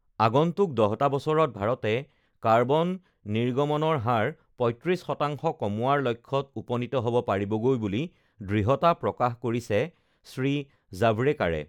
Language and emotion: Assamese, neutral